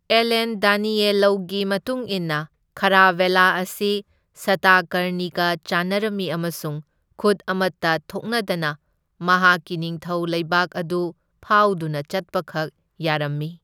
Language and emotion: Manipuri, neutral